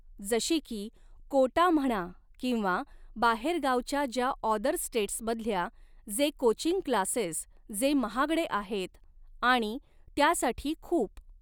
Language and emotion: Marathi, neutral